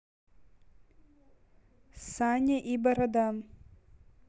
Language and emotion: Russian, neutral